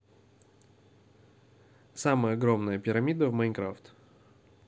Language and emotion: Russian, neutral